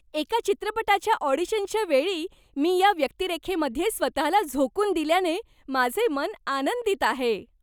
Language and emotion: Marathi, happy